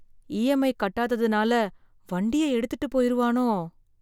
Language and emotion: Tamil, fearful